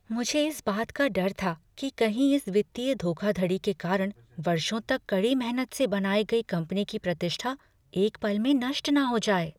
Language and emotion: Hindi, fearful